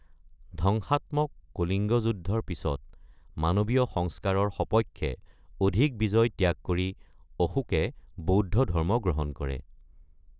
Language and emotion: Assamese, neutral